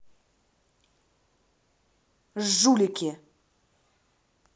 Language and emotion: Russian, angry